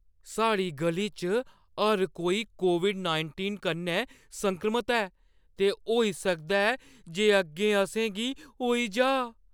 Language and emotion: Dogri, fearful